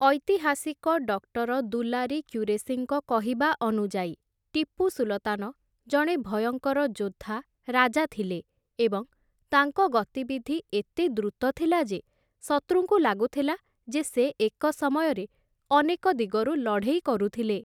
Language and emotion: Odia, neutral